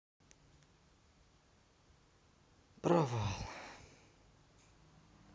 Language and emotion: Russian, sad